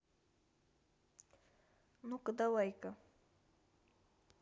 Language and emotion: Russian, neutral